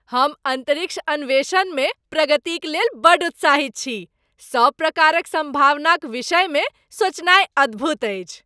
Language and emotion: Maithili, happy